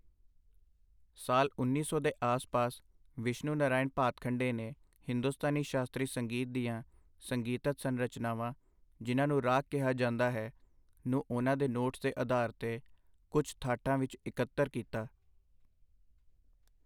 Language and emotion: Punjabi, neutral